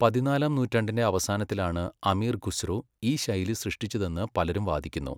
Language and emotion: Malayalam, neutral